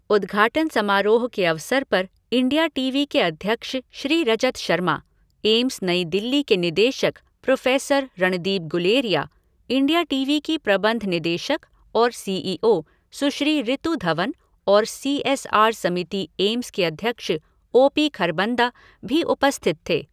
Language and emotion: Hindi, neutral